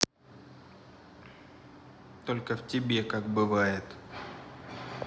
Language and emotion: Russian, angry